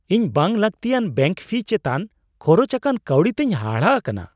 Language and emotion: Santali, surprised